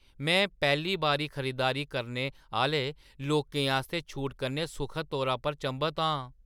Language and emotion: Dogri, surprised